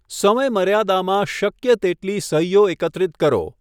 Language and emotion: Gujarati, neutral